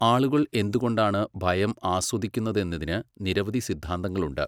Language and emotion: Malayalam, neutral